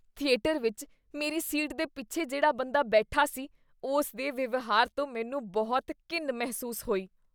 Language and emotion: Punjabi, disgusted